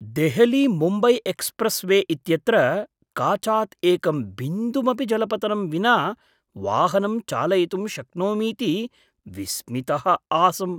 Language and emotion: Sanskrit, surprised